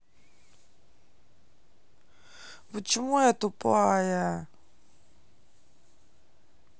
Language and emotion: Russian, sad